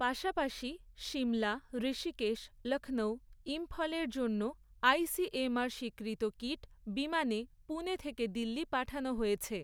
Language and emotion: Bengali, neutral